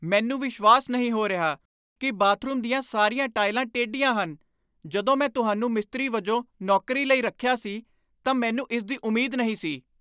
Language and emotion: Punjabi, angry